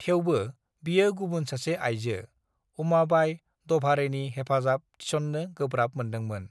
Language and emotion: Bodo, neutral